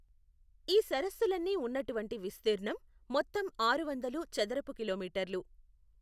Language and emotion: Telugu, neutral